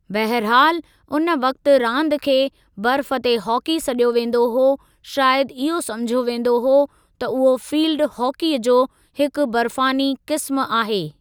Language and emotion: Sindhi, neutral